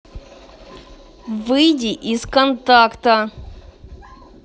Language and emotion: Russian, angry